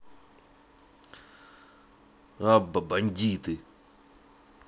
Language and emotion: Russian, angry